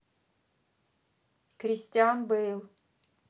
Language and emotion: Russian, neutral